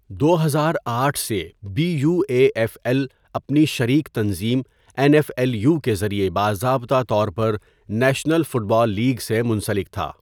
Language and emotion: Urdu, neutral